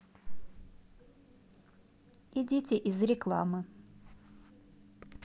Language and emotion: Russian, neutral